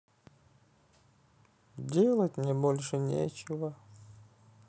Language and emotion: Russian, sad